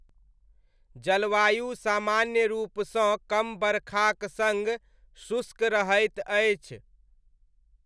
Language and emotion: Maithili, neutral